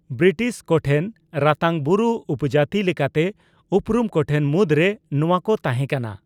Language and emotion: Santali, neutral